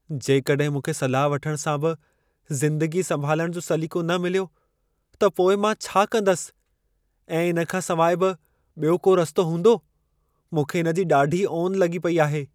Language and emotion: Sindhi, fearful